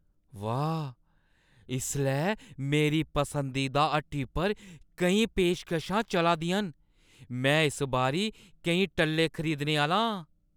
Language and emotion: Dogri, surprised